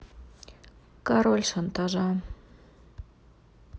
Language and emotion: Russian, neutral